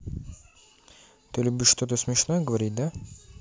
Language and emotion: Russian, neutral